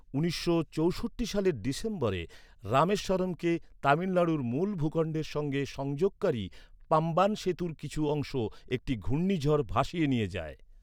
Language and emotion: Bengali, neutral